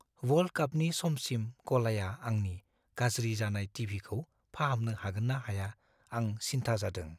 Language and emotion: Bodo, fearful